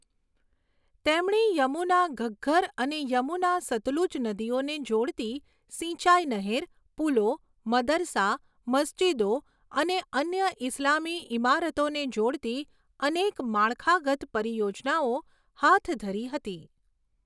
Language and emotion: Gujarati, neutral